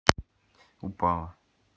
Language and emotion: Russian, neutral